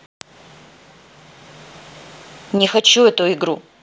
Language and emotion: Russian, angry